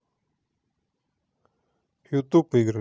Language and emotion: Russian, neutral